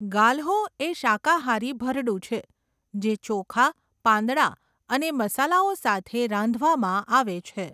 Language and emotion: Gujarati, neutral